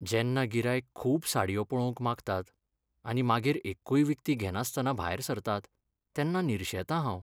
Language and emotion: Goan Konkani, sad